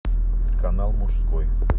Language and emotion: Russian, neutral